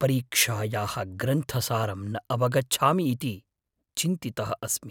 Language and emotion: Sanskrit, fearful